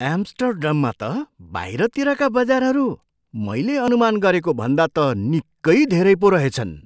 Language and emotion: Nepali, surprised